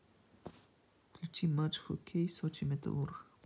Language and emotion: Russian, neutral